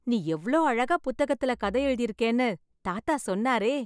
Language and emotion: Tamil, happy